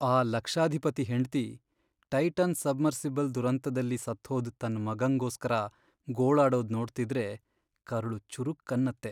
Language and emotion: Kannada, sad